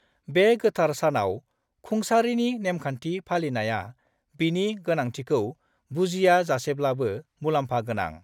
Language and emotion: Bodo, neutral